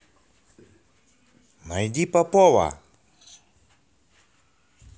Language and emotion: Russian, positive